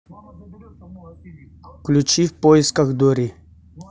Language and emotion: Russian, neutral